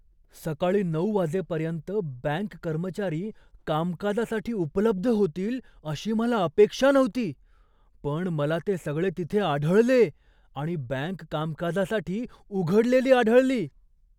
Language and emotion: Marathi, surprised